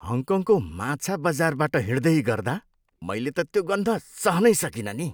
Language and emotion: Nepali, disgusted